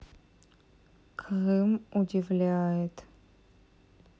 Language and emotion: Russian, sad